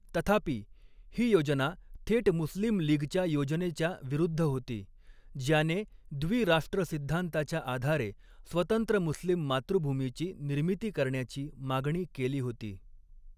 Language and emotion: Marathi, neutral